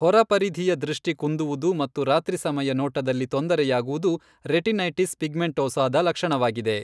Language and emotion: Kannada, neutral